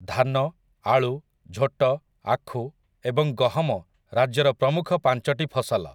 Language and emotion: Odia, neutral